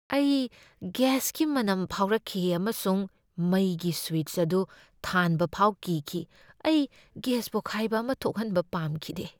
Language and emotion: Manipuri, fearful